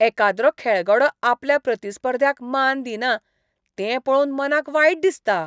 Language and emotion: Goan Konkani, disgusted